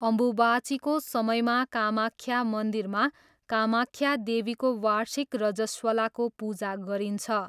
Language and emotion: Nepali, neutral